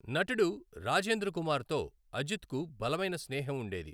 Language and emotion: Telugu, neutral